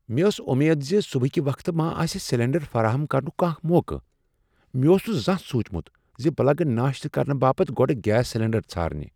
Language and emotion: Kashmiri, surprised